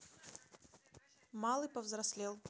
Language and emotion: Russian, neutral